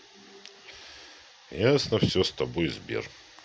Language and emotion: Russian, neutral